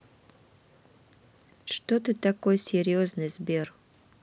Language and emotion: Russian, neutral